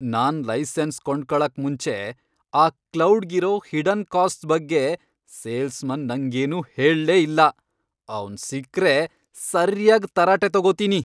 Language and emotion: Kannada, angry